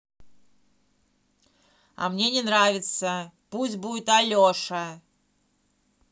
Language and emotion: Russian, angry